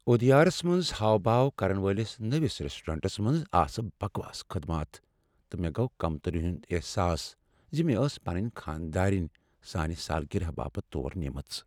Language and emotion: Kashmiri, sad